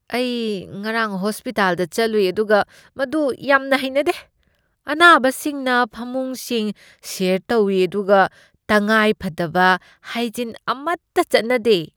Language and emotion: Manipuri, disgusted